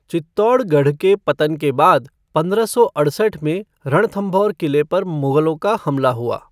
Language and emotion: Hindi, neutral